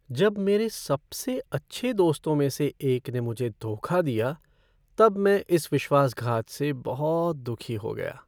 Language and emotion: Hindi, sad